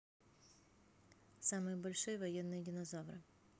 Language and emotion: Russian, neutral